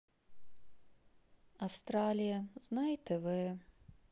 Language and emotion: Russian, sad